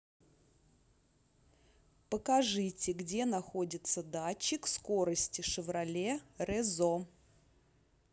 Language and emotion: Russian, neutral